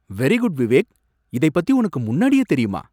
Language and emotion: Tamil, surprised